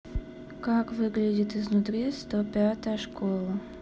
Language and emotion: Russian, neutral